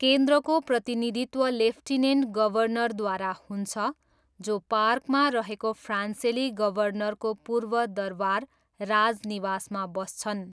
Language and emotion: Nepali, neutral